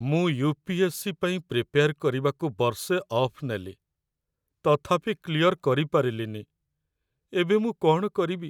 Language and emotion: Odia, sad